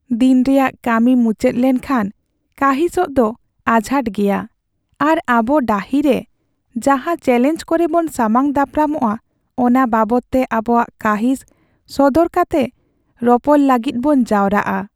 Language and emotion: Santali, sad